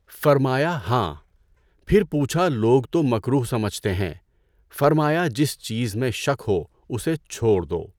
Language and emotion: Urdu, neutral